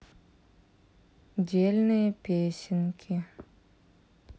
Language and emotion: Russian, sad